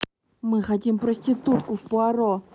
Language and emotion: Russian, angry